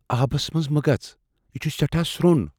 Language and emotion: Kashmiri, fearful